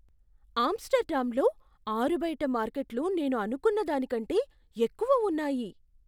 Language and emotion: Telugu, surprised